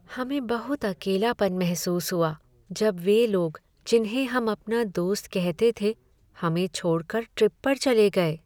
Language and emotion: Hindi, sad